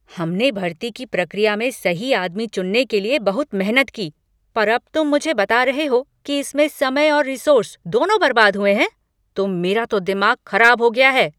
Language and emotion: Hindi, angry